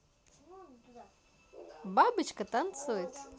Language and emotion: Russian, positive